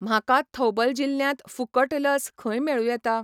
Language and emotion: Goan Konkani, neutral